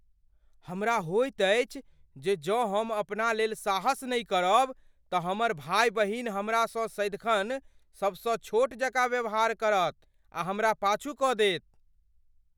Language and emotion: Maithili, fearful